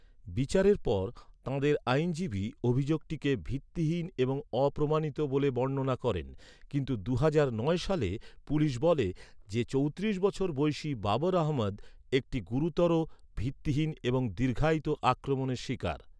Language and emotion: Bengali, neutral